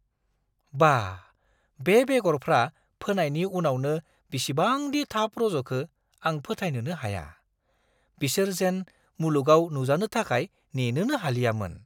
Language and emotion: Bodo, surprised